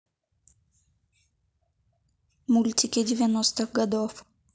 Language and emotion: Russian, neutral